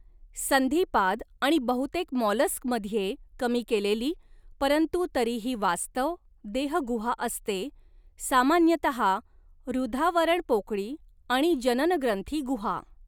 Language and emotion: Marathi, neutral